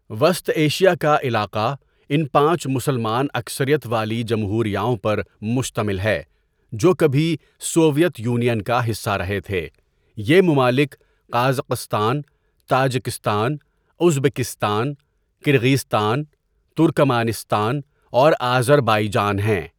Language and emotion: Urdu, neutral